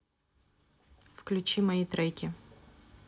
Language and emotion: Russian, neutral